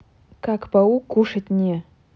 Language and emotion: Russian, neutral